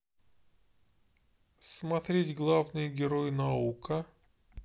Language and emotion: Russian, neutral